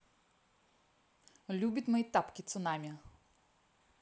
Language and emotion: Russian, neutral